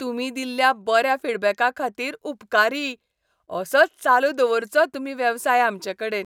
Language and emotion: Goan Konkani, happy